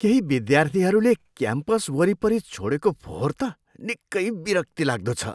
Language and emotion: Nepali, disgusted